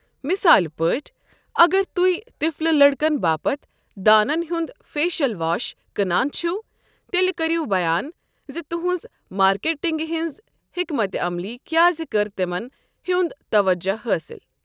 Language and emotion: Kashmiri, neutral